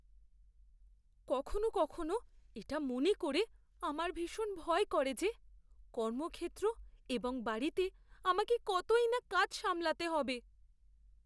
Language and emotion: Bengali, fearful